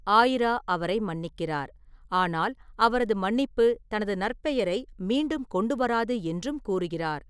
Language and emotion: Tamil, neutral